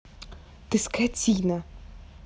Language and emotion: Russian, angry